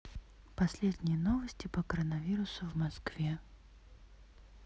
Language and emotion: Russian, neutral